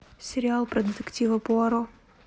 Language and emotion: Russian, neutral